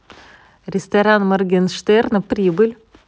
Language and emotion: Russian, neutral